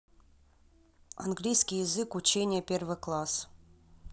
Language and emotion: Russian, neutral